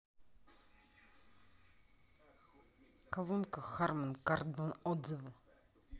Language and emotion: Russian, neutral